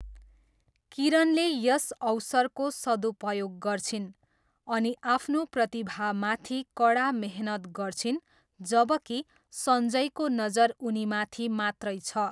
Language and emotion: Nepali, neutral